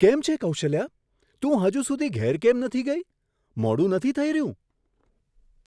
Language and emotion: Gujarati, surprised